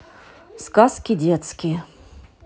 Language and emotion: Russian, neutral